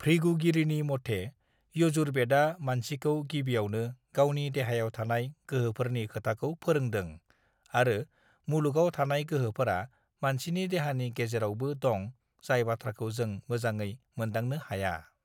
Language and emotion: Bodo, neutral